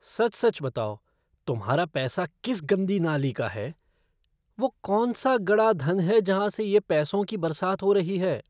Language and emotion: Hindi, disgusted